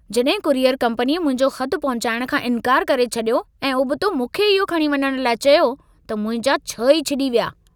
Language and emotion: Sindhi, angry